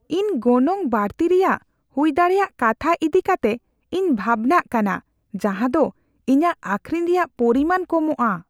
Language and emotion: Santali, fearful